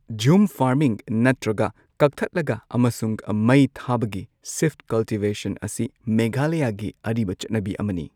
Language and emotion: Manipuri, neutral